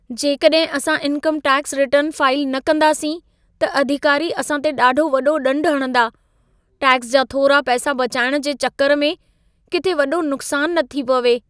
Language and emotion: Sindhi, fearful